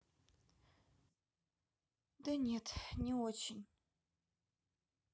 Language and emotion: Russian, sad